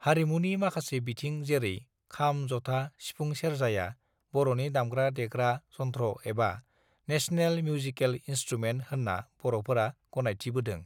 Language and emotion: Bodo, neutral